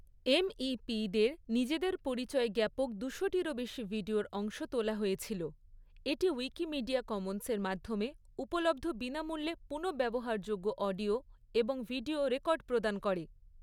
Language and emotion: Bengali, neutral